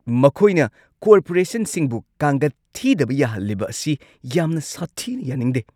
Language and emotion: Manipuri, angry